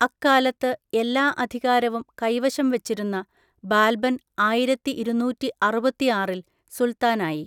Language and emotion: Malayalam, neutral